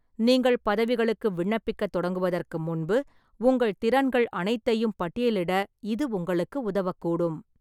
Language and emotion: Tamil, neutral